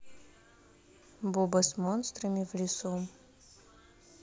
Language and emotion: Russian, neutral